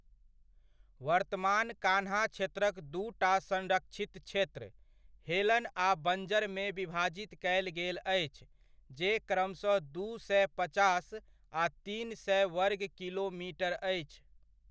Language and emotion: Maithili, neutral